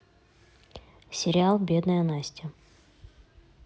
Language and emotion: Russian, neutral